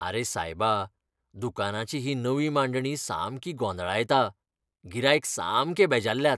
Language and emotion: Goan Konkani, disgusted